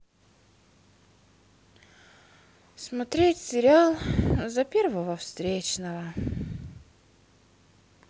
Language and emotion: Russian, sad